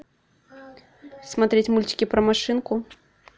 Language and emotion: Russian, neutral